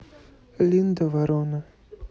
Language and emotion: Russian, neutral